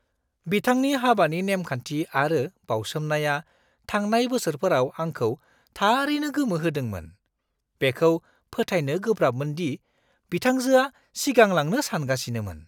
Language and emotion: Bodo, surprised